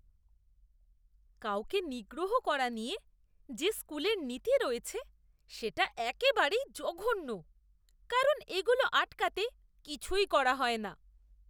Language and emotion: Bengali, disgusted